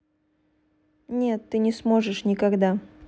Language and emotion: Russian, neutral